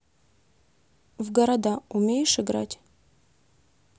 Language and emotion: Russian, neutral